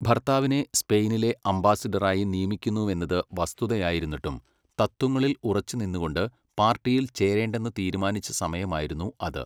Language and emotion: Malayalam, neutral